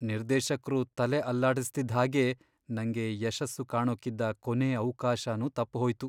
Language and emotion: Kannada, sad